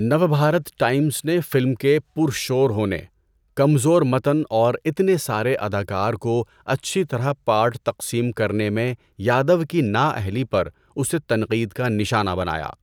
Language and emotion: Urdu, neutral